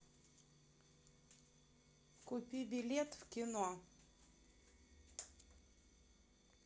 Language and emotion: Russian, neutral